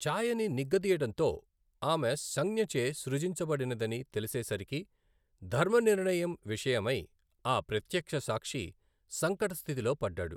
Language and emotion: Telugu, neutral